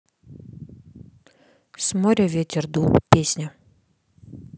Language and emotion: Russian, neutral